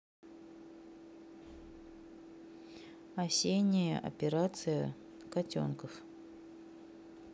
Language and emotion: Russian, neutral